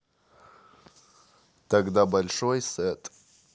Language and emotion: Russian, neutral